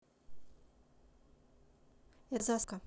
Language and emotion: Russian, neutral